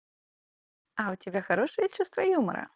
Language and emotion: Russian, positive